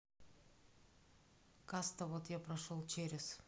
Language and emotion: Russian, neutral